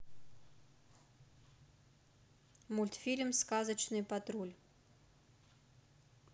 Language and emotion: Russian, neutral